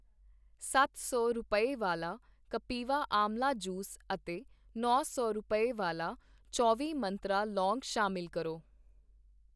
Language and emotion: Punjabi, neutral